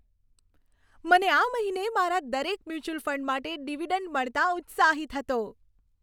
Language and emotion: Gujarati, happy